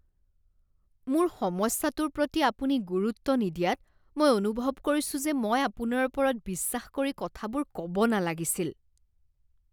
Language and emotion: Assamese, disgusted